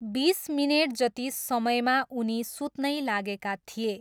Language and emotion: Nepali, neutral